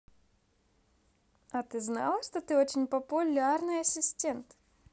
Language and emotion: Russian, positive